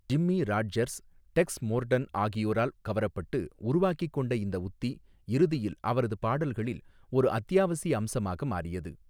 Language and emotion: Tamil, neutral